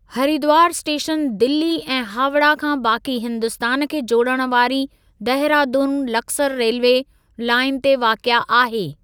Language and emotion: Sindhi, neutral